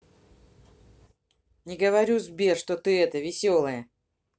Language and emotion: Russian, neutral